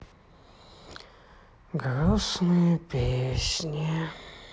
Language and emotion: Russian, sad